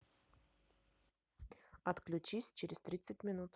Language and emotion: Russian, neutral